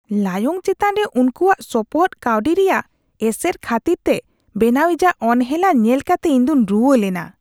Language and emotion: Santali, disgusted